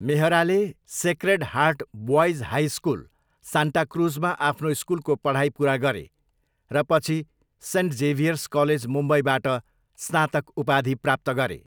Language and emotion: Nepali, neutral